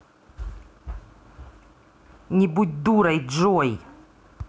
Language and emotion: Russian, angry